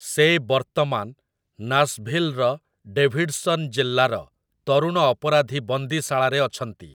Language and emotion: Odia, neutral